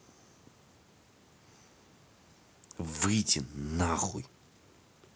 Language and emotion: Russian, angry